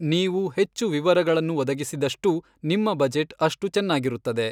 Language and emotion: Kannada, neutral